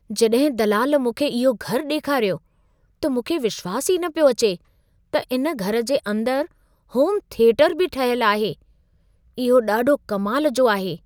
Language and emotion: Sindhi, surprised